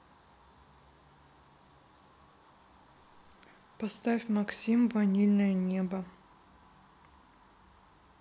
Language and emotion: Russian, neutral